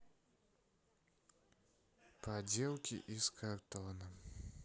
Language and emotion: Russian, sad